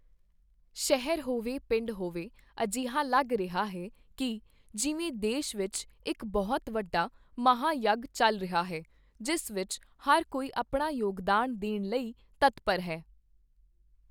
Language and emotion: Punjabi, neutral